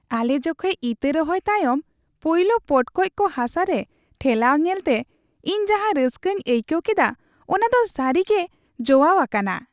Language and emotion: Santali, happy